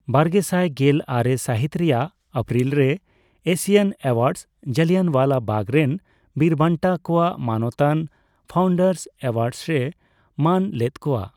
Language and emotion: Santali, neutral